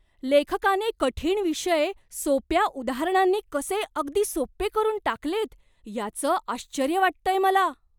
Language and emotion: Marathi, surprised